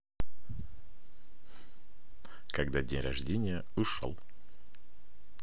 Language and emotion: Russian, positive